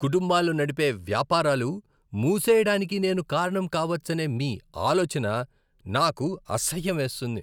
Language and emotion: Telugu, disgusted